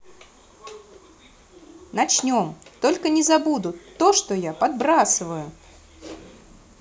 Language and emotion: Russian, positive